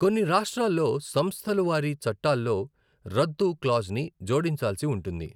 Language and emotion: Telugu, neutral